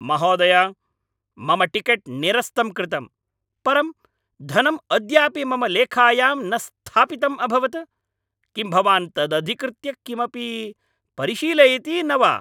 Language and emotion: Sanskrit, angry